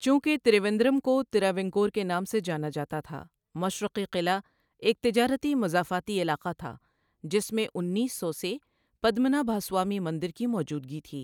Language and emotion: Urdu, neutral